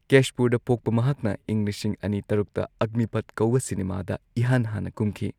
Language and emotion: Manipuri, neutral